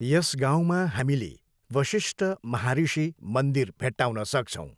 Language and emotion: Nepali, neutral